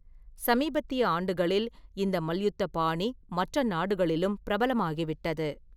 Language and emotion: Tamil, neutral